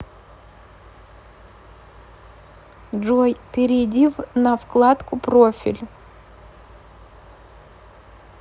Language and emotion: Russian, neutral